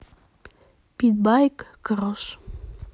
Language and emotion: Russian, neutral